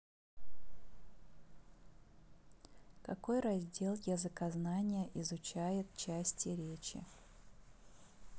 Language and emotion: Russian, neutral